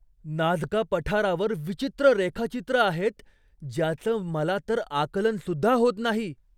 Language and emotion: Marathi, surprised